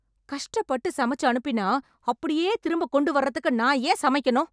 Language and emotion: Tamil, angry